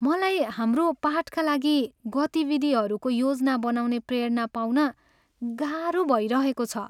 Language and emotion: Nepali, sad